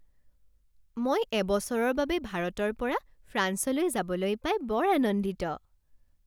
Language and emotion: Assamese, happy